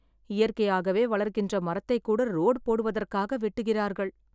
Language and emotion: Tamil, sad